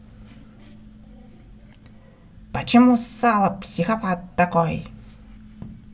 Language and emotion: Russian, angry